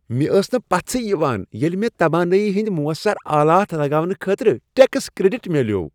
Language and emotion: Kashmiri, happy